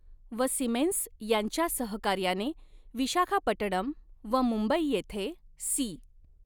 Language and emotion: Marathi, neutral